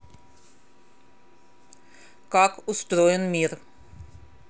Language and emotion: Russian, neutral